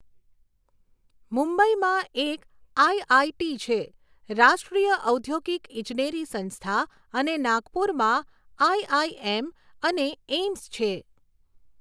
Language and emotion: Gujarati, neutral